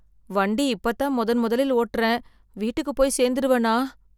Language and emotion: Tamil, fearful